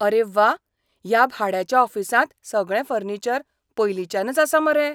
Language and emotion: Goan Konkani, surprised